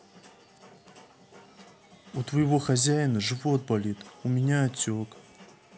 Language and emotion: Russian, sad